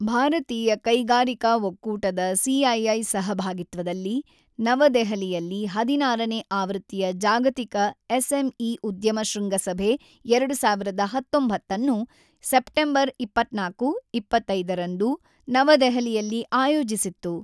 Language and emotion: Kannada, neutral